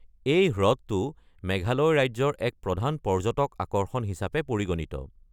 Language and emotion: Assamese, neutral